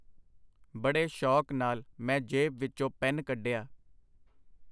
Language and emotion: Punjabi, neutral